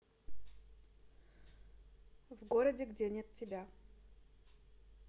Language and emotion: Russian, neutral